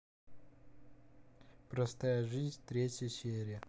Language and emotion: Russian, neutral